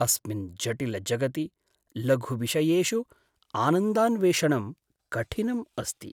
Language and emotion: Sanskrit, sad